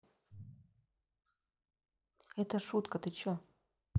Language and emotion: Russian, neutral